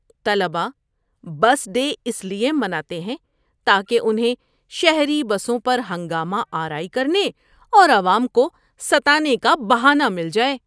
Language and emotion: Urdu, disgusted